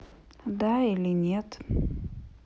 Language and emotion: Russian, neutral